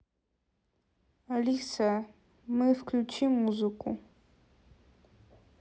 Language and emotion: Russian, neutral